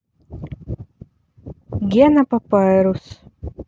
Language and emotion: Russian, neutral